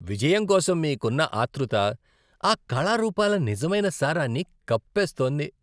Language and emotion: Telugu, disgusted